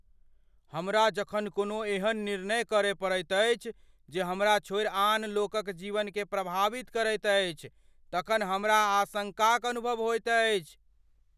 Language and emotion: Maithili, fearful